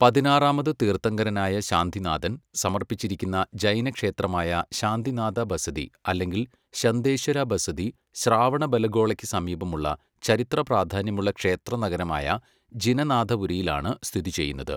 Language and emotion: Malayalam, neutral